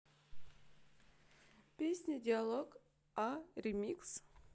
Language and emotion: Russian, neutral